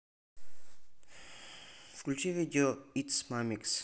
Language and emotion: Russian, neutral